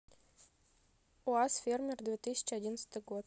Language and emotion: Russian, neutral